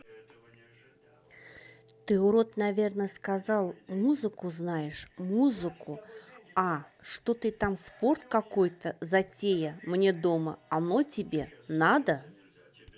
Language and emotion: Russian, neutral